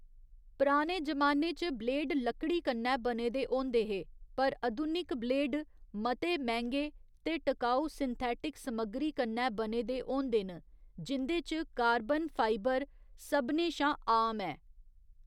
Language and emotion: Dogri, neutral